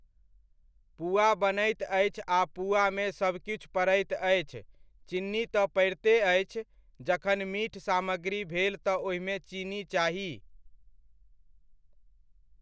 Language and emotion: Maithili, neutral